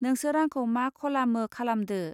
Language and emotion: Bodo, neutral